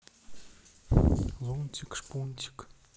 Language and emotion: Russian, sad